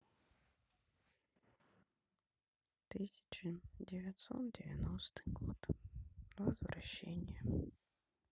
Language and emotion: Russian, sad